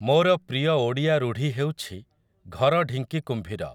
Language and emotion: Odia, neutral